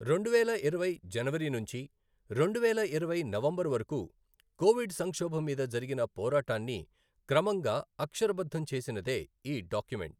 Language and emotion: Telugu, neutral